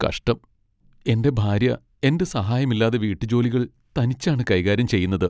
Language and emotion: Malayalam, sad